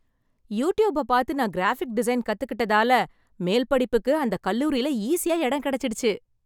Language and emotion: Tamil, happy